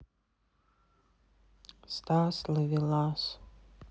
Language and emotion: Russian, sad